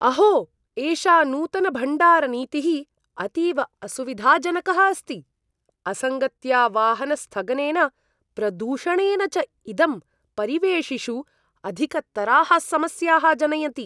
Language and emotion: Sanskrit, disgusted